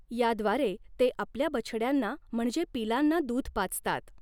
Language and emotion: Marathi, neutral